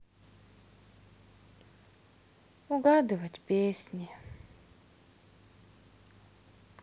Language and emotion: Russian, sad